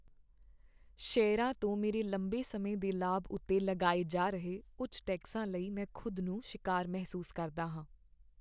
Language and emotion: Punjabi, sad